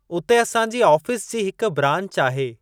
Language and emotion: Sindhi, neutral